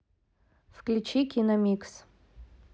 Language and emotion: Russian, neutral